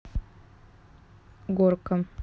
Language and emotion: Russian, neutral